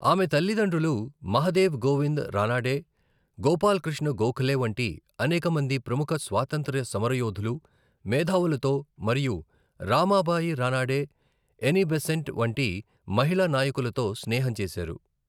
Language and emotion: Telugu, neutral